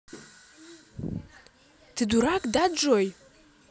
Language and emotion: Russian, angry